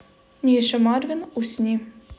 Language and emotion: Russian, neutral